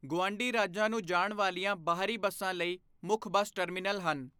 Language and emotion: Punjabi, neutral